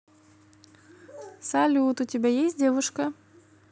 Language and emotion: Russian, positive